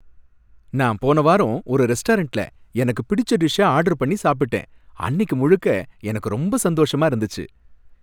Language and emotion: Tamil, happy